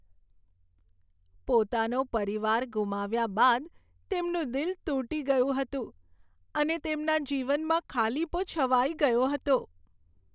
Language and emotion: Gujarati, sad